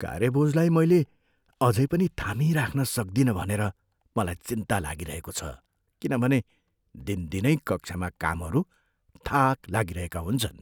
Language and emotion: Nepali, fearful